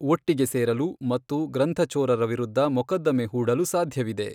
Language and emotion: Kannada, neutral